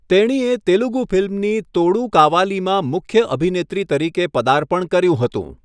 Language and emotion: Gujarati, neutral